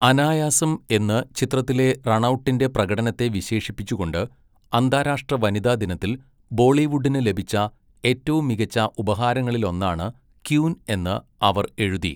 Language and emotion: Malayalam, neutral